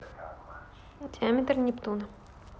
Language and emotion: Russian, neutral